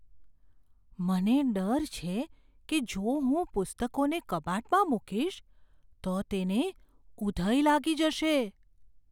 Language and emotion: Gujarati, fearful